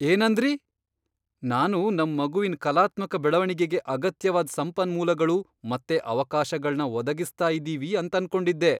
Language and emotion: Kannada, surprised